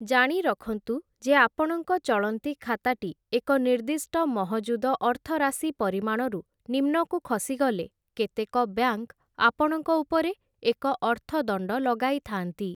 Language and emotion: Odia, neutral